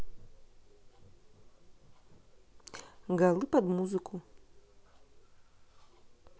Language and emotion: Russian, neutral